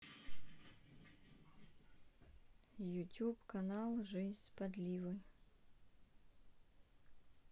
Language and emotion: Russian, neutral